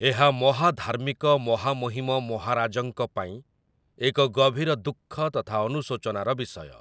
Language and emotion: Odia, neutral